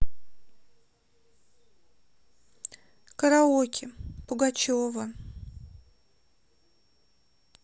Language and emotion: Russian, sad